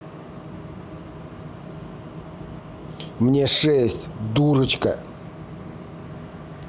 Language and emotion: Russian, angry